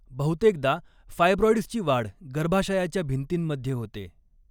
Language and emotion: Marathi, neutral